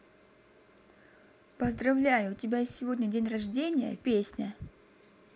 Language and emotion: Russian, positive